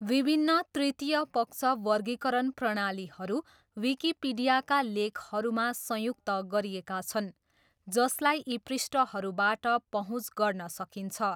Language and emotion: Nepali, neutral